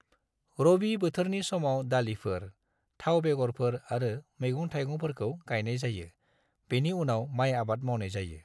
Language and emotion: Bodo, neutral